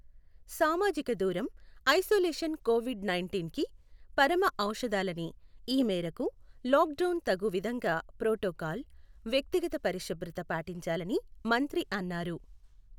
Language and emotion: Telugu, neutral